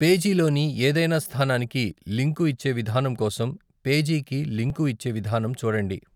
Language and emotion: Telugu, neutral